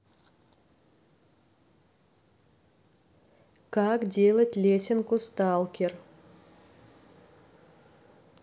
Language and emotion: Russian, neutral